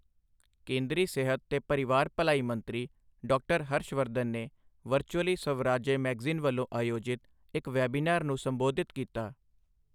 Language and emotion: Punjabi, neutral